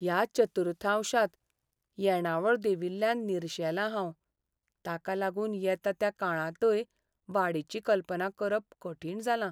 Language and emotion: Goan Konkani, sad